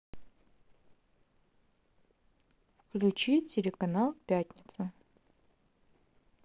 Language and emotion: Russian, neutral